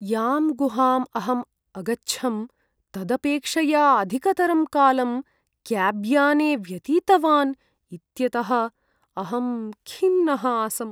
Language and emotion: Sanskrit, sad